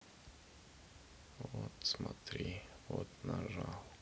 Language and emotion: Russian, sad